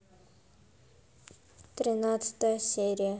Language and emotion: Russian, neutral